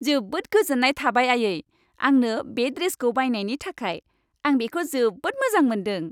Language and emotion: Bodo, happy